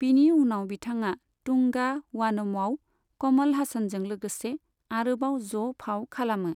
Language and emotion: Bodo, neutral